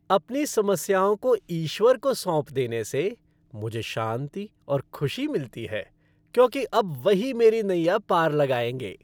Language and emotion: Hindi, happy